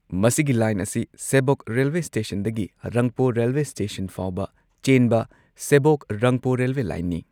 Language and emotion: Manipuri, neutral